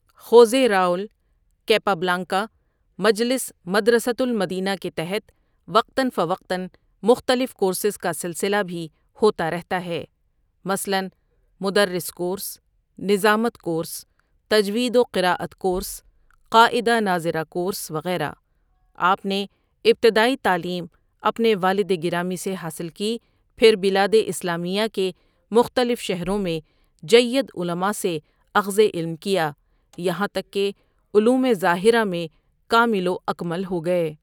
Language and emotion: Urdu, neutral